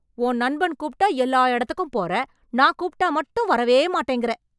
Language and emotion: Tamil, angry